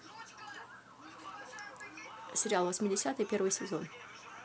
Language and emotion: Russian, neutral